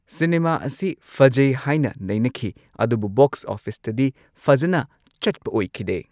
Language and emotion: Manipuri, neutral